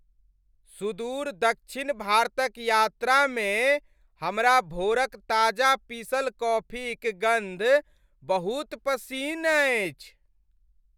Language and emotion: Maithili, happy